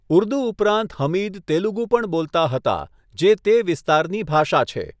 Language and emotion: Gujarati, neutral